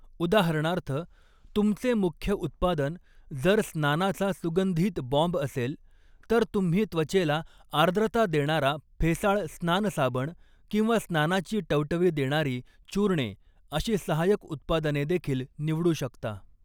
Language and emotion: Marathi, neutral